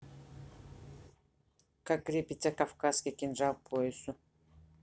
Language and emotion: Russian, neutral